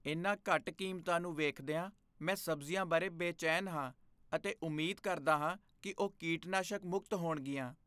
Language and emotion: Punjabi, fearful